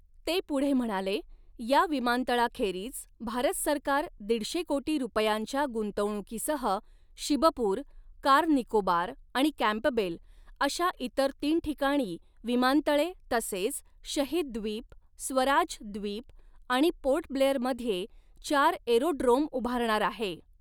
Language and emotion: Marathi, neutral